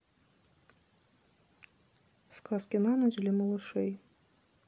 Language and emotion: Russian, neutral